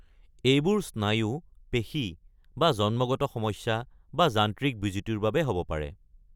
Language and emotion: Assamese, neutral